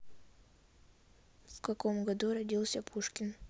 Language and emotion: Russian, neutral